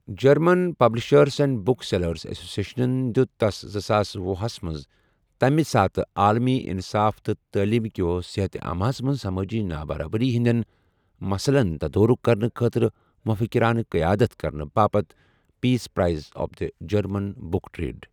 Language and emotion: Kashmiri, neutral